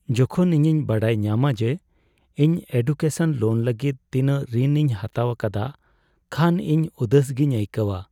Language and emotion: Santali, sad